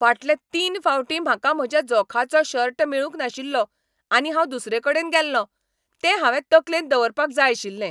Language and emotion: Goan Konkani, angry